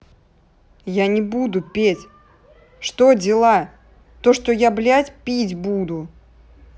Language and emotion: Russian, angry